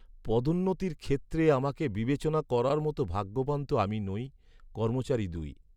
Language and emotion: Bengali, sad